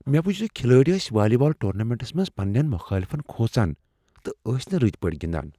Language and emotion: Kashmiri, fearful